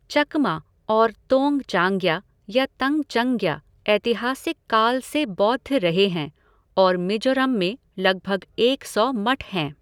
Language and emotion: Hindi, neutral